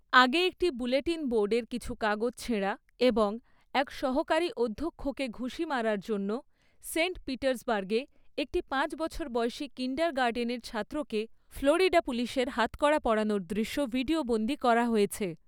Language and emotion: Bengali, neutral